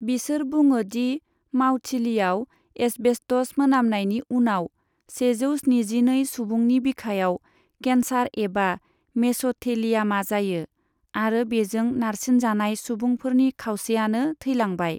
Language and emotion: Bodo, neutral